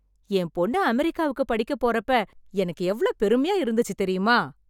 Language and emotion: Tamil, happy